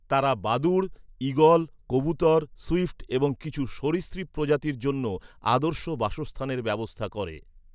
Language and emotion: Bengali, neutral